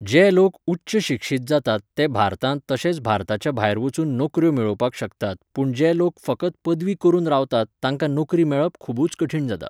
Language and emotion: Goan Konkani, neutral